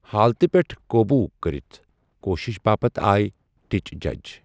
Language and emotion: Kashmiri, neutral